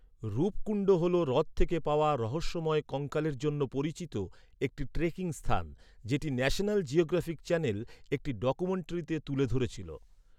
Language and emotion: Bengali, neutral